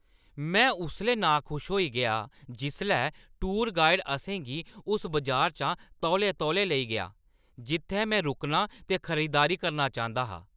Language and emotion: Dogri, angry